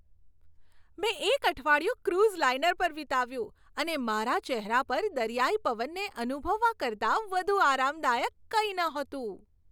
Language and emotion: Gujarati, happy